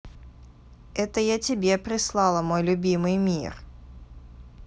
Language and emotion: Russian, positive